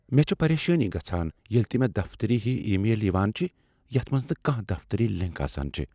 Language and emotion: Kashmiri, fearful